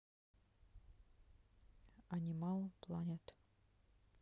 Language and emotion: Russian, neutral